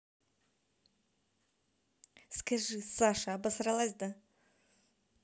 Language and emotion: Russian, neutral